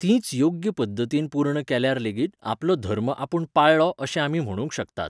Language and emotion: Goan Konkani, neutral